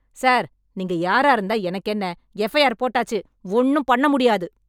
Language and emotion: Tamil, angry